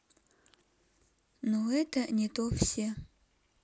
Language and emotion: Russian, neutral